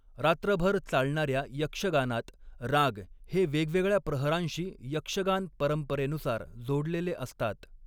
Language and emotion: Marathi, neutral